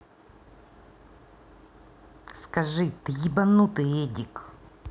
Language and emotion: Russian, angry